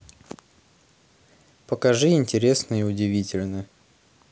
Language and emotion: Russian, neutral